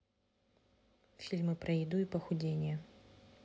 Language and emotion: Russian, neutral